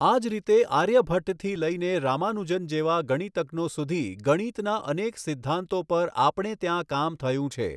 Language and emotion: Gujarati, neutral